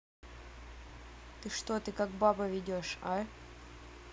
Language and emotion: Russian, neutral